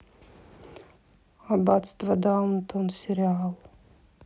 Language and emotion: Russian, neutral